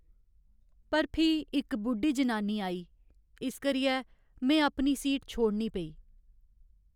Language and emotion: Dogri, sad